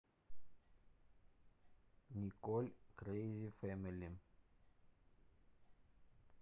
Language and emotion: Russian, neutral